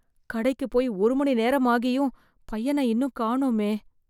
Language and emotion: Tamil, fearful